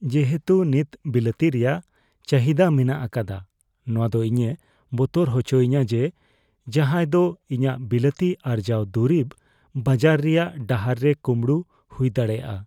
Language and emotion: Santali, fearful